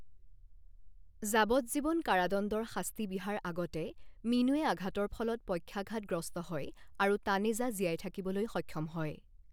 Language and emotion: Assamese, neutral